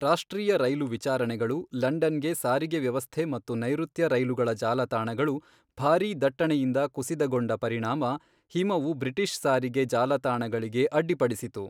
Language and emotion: Kannada, neutral